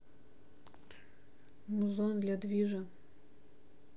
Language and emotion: Russian, neutral